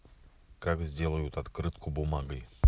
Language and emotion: Russian, neutral